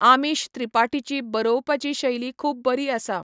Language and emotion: Goan Konkani, neutral